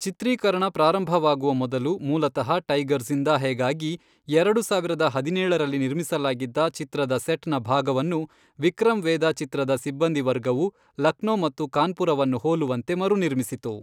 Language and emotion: Kannada, neutral